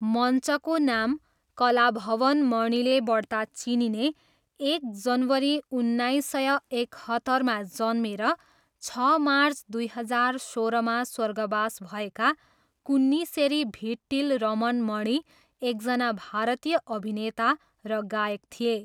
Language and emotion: Nepali, neutral